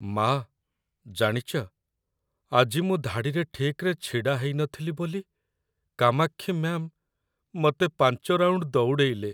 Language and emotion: Odia, sad